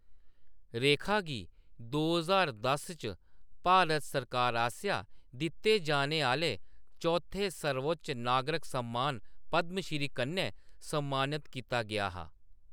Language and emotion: Dogri, neutral